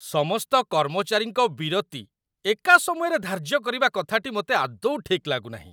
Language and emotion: Odia, disgusted